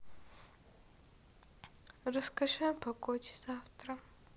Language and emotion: Russian, sad